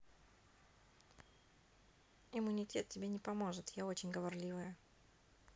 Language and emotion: Russian, neutral